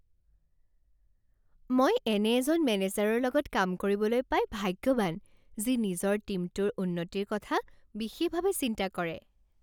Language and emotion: Assamese, happy